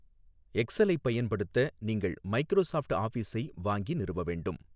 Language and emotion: Tamil, neutral